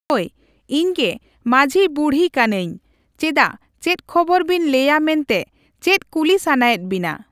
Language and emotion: Santali, neutral